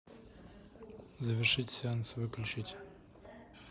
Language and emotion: Russian, neutral